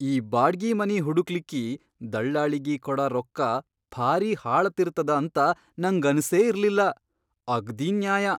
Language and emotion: Kannada, surprised